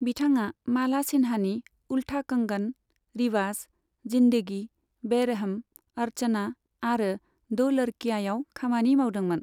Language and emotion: Bodo, neutral